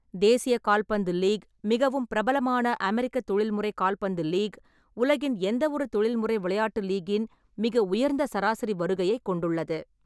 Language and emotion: Tamil, neutral